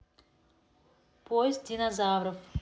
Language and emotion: Russian, neutral